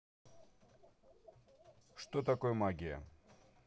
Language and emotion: Russian, neutral